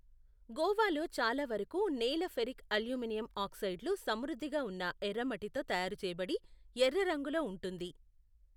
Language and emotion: Telugu, neutral